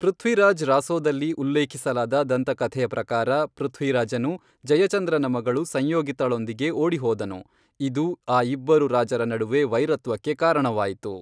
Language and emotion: Kannada, neutral